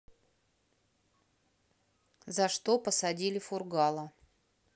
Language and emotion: Russian, neutral